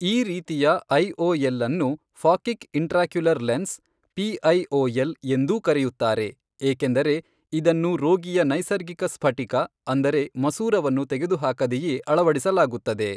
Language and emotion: Kannada, neutral